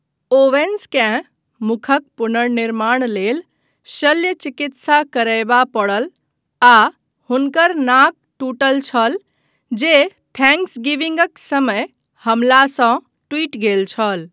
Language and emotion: Maithili, neutral